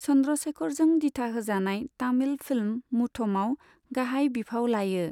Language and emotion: Bodo, neutral